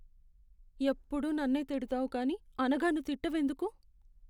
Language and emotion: Telugu, sad